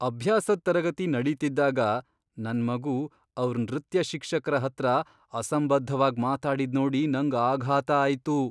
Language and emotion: Kannada, surprised